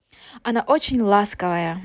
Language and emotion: Russian, positive